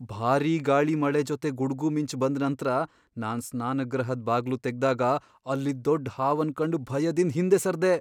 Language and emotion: Kannada, fearful